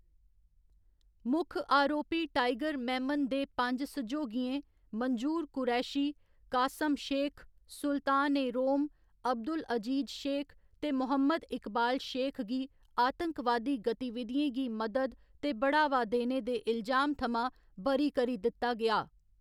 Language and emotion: Dogri, neutral